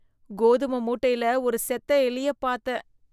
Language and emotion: Tamil, disgusted